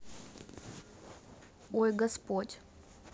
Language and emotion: Russian, neutral